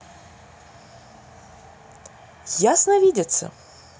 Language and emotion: Russian, positive